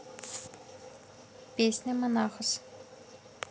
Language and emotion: Russian, neutral